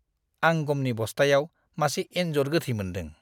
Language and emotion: Bodo, disgusted